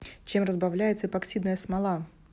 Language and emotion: Russian, neutral